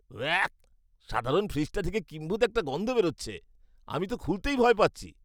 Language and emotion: Bengali, disgusted